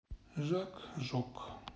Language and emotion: Russian, neutral